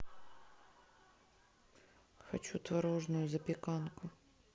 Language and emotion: Russian, neutral